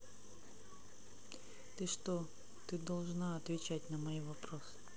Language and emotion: Russian, neutral